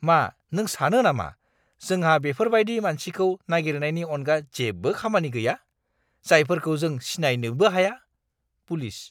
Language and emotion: Bodo, disgusted